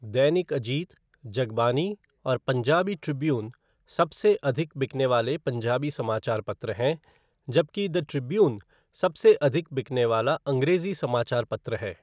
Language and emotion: Hindi, neutral